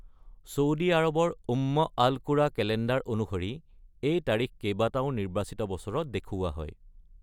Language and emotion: Assamese, neutral